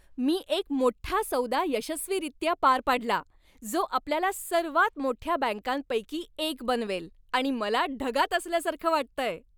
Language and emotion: Marathi, happy